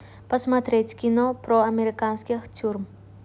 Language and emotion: Russian, neutral